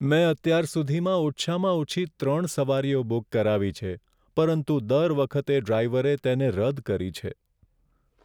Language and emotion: Gujarati, sad